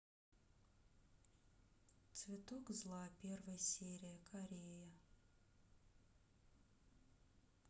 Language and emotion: Russian, neutral